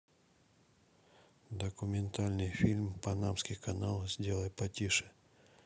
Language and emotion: Russian, neutral